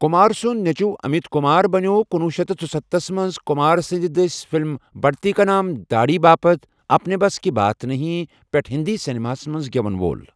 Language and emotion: Kashmiri, neutral